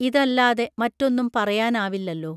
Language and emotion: Malayalam, neutral